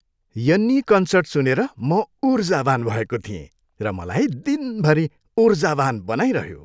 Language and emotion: Nepali, happy